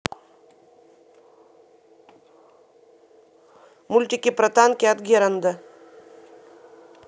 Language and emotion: Russian, neutral